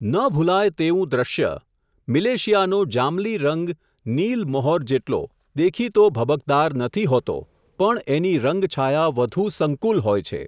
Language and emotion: Gujarati, neutral